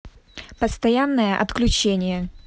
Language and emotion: Russian, angry